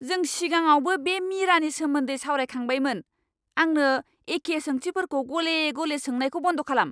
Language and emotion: Bodo, angry